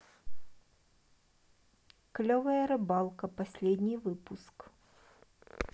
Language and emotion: Russian, neutral